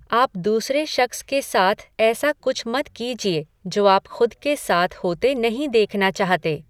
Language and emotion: Hindi, neutral